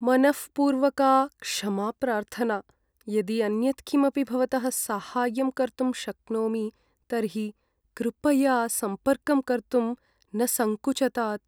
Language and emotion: Sanskrit, sad